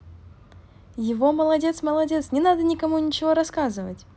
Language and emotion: Russian, positive